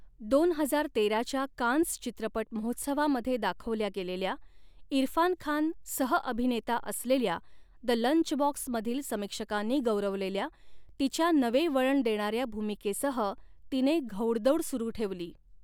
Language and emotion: Marathi, neutral